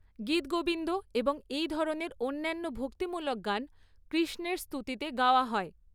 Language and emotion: Bengali, neutral